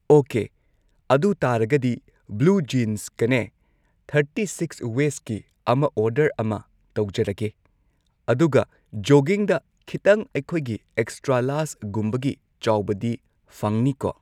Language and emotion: Manipuri, neutral